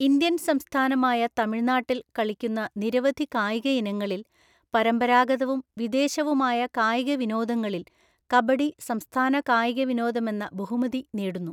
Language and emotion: Malayalam, neutral